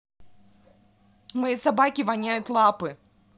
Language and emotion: Russian, angry